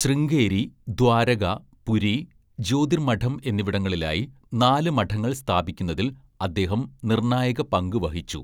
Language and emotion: Malayalam, neutral